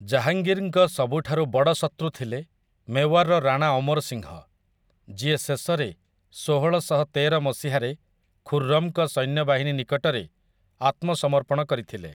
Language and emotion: Odia, neutral